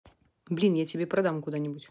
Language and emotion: Russian, neutral